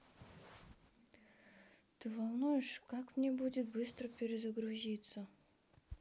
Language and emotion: Russian, neutral